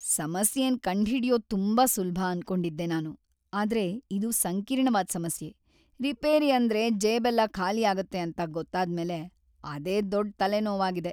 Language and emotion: Kannada, sad